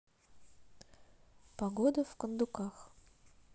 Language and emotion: Russian, neutral